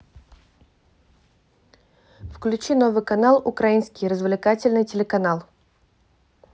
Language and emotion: Russian, neutral